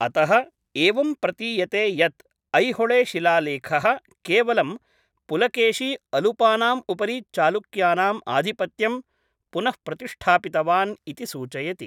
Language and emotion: Sanskrit, neutral